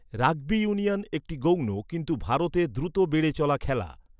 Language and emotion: Bengali, neutral